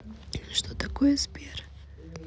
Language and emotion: Russian, neutral